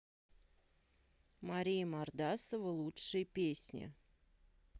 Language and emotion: Russian, neutral